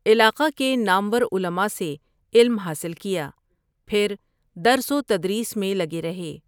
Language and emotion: Urdu, neutral